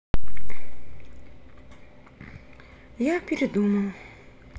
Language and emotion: Russian, sad